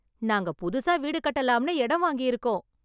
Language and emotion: Tamil, happy